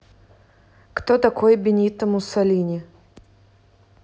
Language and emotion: Russian, neutral